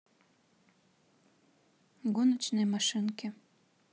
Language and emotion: Russian, neutral